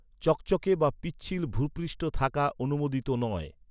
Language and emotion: Bengali, neutral